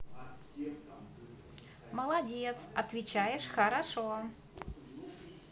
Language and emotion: Russian, positive